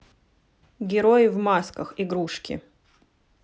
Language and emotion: Russian, neutral